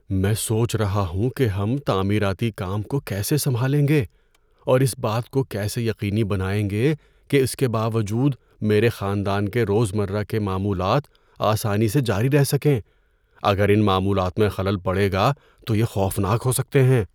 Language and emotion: Urdu, fearful